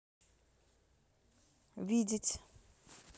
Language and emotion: Russian, neutral